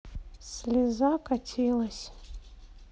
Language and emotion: Russian, sad